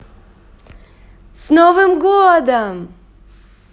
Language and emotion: Russian, positive